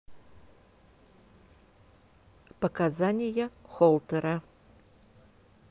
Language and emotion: Russian, neutral